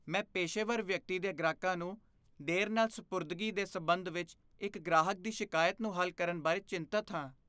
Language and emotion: Punjabi, fearful